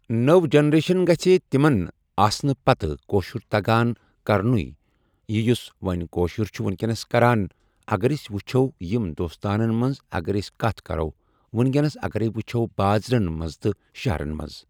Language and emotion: Kashmiri, neutral